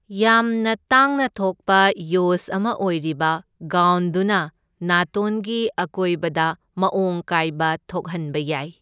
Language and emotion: Manipuri, neutral